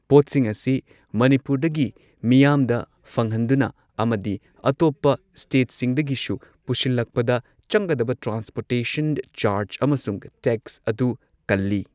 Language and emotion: Manipuri, neutral